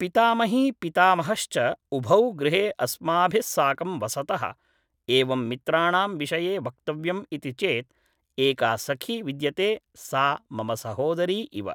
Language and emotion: Sanskrit, neutral